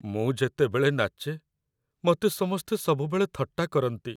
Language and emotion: Odia, sad